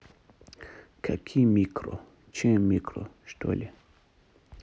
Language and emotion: Russian, neutral